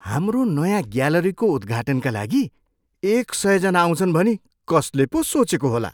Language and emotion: Nepali, surprised